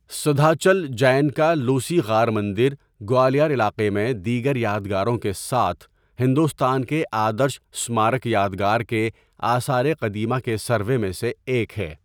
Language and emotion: Urdu, neutral